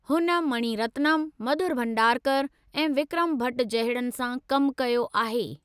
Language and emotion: Sindhi, neutral